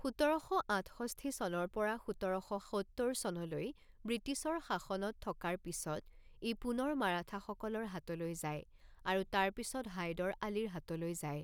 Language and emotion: Assamese, neutral